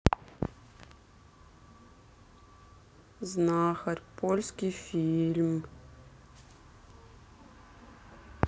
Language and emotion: Russian, sad